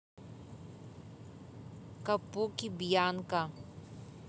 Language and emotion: Russian, neutral